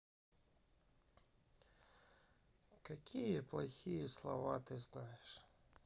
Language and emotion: Russian, sad